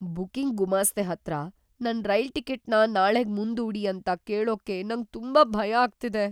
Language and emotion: Kannada, fearful